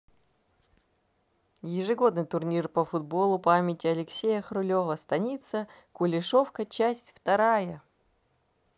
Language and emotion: Russian, positive